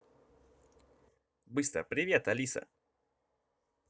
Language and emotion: Russian, positive